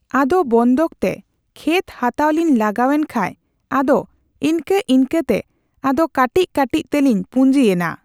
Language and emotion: Santali, neutral